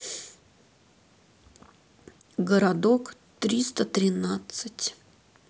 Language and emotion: Russian, sad